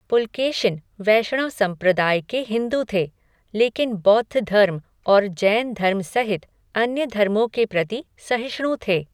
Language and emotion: Hindi, neutral